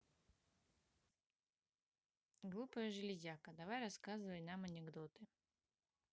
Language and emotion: Russian, neutral